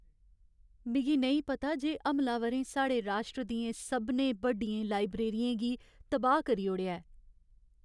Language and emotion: Dogri, sad